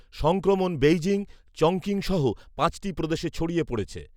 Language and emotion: Bengali, neutral